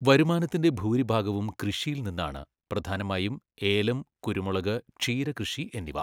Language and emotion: Malayalam, neutral